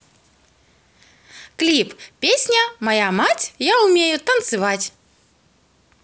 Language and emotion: Russian, positive